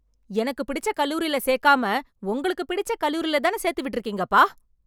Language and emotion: Tamil, angry